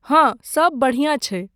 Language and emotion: Maithili, neutral